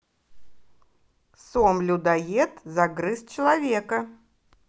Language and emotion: Russian, positive